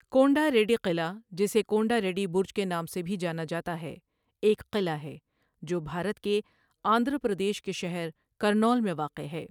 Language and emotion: Urdu, neutral